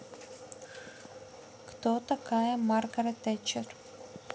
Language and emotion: Russian, neutral